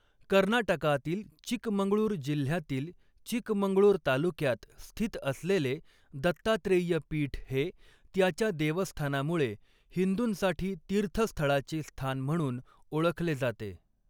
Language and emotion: Marathi, neutral